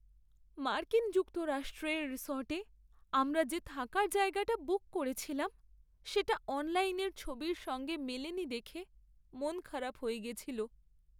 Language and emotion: Bengali, sad